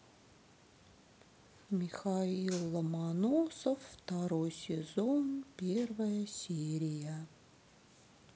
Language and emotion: Russian, sad